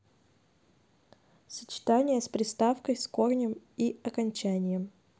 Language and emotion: Russian, neutral